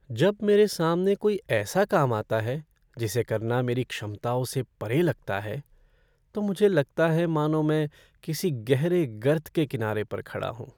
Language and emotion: Hindi, sad